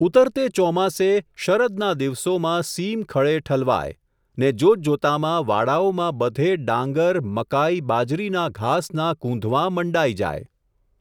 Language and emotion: Gujarati, neutral